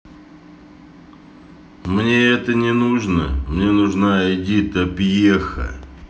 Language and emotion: Russian, neutral